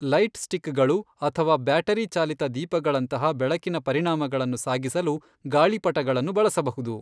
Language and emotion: Kannada, neutral